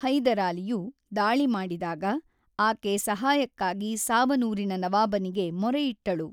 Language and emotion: Kannada, neutral